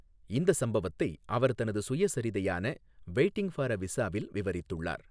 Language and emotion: Tamil, neutral